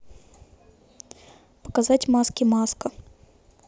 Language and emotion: Russian, neutral